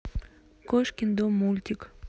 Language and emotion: Russian, neutral